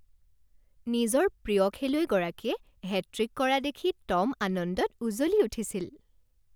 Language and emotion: Assamese, happy